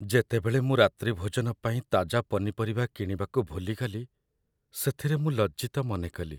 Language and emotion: Odia, sad